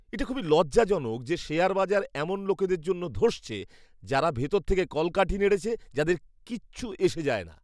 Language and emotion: Bengali, disgusted